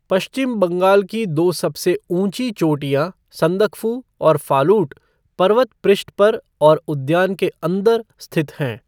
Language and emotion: Hindi, neutral